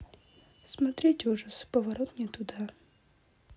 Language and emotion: Russian, neutral